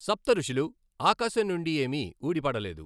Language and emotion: Telugu, neutral